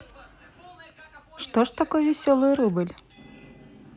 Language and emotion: Russian, positive